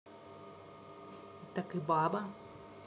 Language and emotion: Russian, neutral